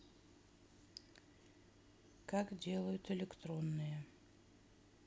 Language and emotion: Russian, neutral